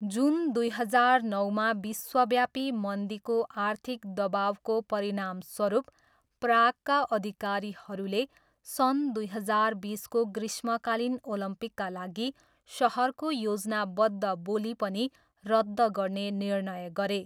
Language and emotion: Nepali, neutral